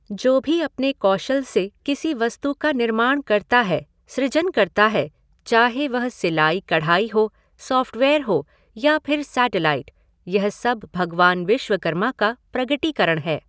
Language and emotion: Hindi, neutral